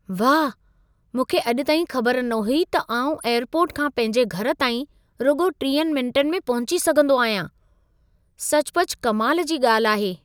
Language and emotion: Sindhi, surprised